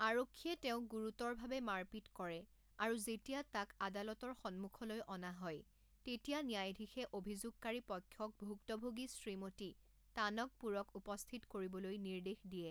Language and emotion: Assamese, neutral